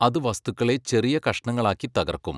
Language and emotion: Malayalam, neutral